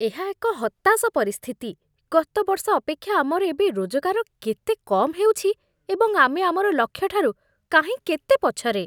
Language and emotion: Odia, disgusted